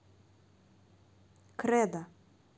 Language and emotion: Russian, neutral